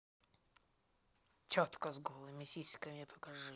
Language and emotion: Russian, neutral